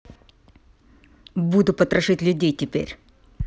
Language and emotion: Russian, angry